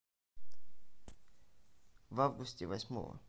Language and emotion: Russian, neutral